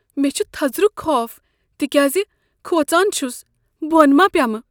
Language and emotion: Kashmiri, fearful